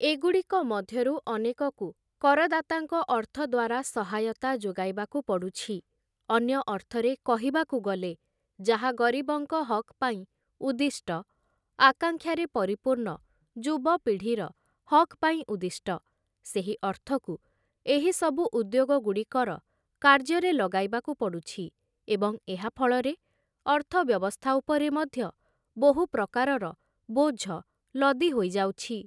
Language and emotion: Odia, neutral